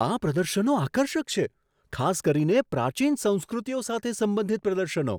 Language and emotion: Gujarati, surprised